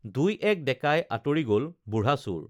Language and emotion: Assamese, neutral